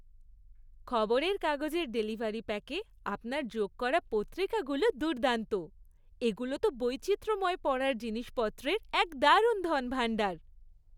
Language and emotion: Bengali, happy